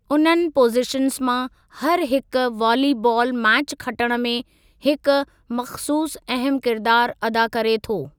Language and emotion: Sindhi, neutral